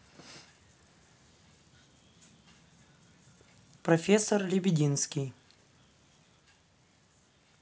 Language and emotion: Russian, neutral